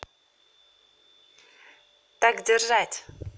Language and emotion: Russian, positive